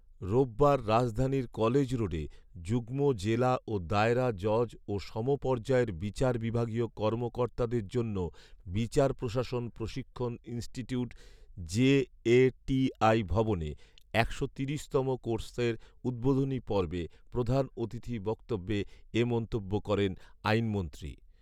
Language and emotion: Bengali, neutral